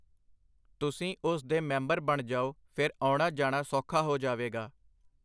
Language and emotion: Punjabi, neutral